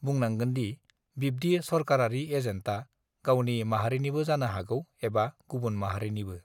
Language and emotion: Bodo, neutral